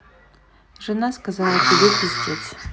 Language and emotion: Russian, neutral